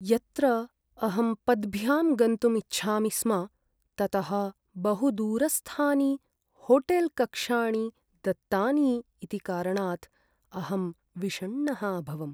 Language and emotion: Sanskrit, sad